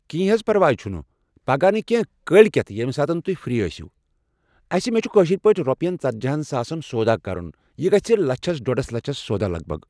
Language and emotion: Kashmiri, neutral